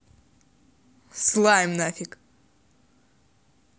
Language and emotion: Russian, angry